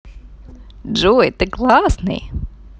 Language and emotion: Russian, positive